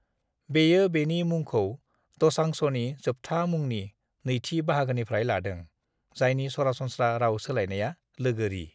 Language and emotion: Bodo, neutral